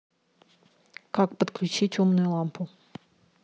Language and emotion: Russian, neutral